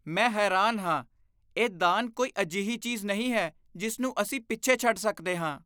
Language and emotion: Punjabi, disgusted